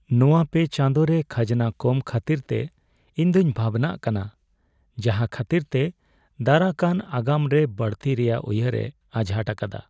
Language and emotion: Santali, sad